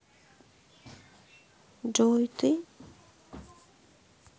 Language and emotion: Russian, sad